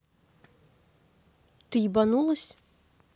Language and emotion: Russian, angry